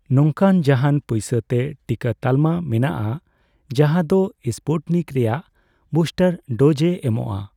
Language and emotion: Santali, neutral